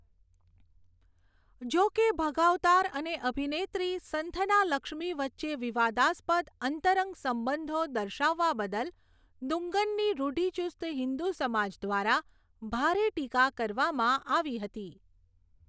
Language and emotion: Gujarati, neutral